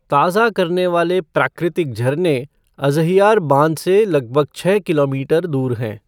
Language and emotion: Hindi, neutral